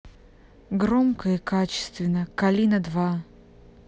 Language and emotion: Russian, neutral